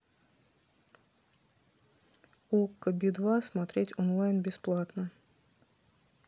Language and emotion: Russian, neutral